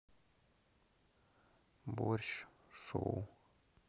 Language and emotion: Russian, sad